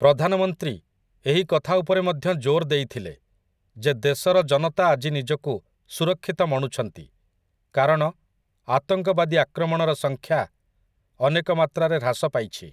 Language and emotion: Odia, neutral